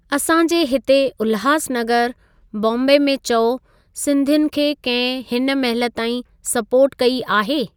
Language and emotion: Sindhi, neutral